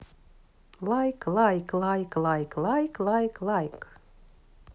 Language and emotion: Russian, neutral